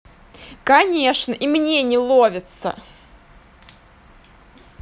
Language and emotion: Russian, angry